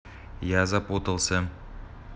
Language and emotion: Russian, neutral